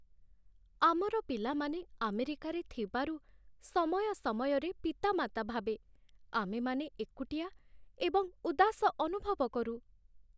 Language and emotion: Odia, sad